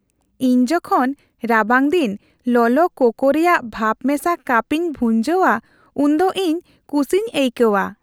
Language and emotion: Santali, happy